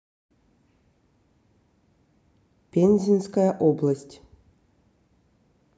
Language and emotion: Russian, neutral